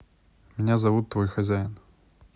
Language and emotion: Russian, neutral